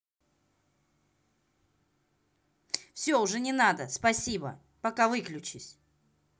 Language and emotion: Russian, angry